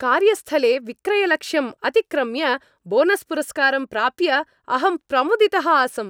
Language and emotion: Sanskrit, happy